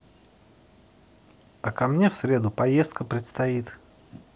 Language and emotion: Russian, positive